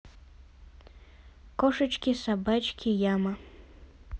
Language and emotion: Russian, neutral